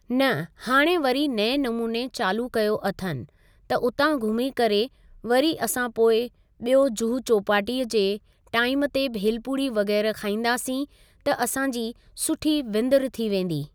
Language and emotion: Sindhi, neutral